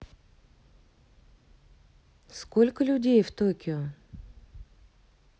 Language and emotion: Russian, neutral